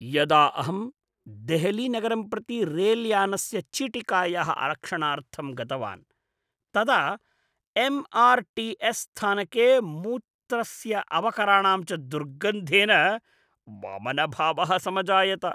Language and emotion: Sanskrit, disgusted